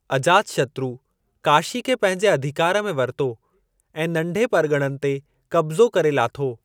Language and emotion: Sindhi, neutral